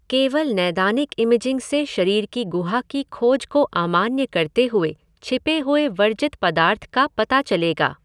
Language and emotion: Hindi, neutral